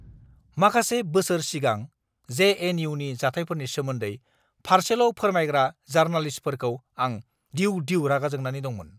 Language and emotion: Bodo, angry